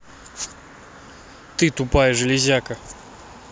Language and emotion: Russian, angry